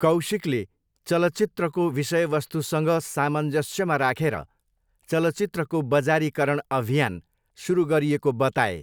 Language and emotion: Nepali, neutral